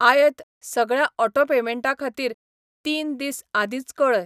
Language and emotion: Goan Konkani, neutral